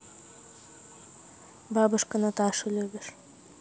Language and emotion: Russian, neutral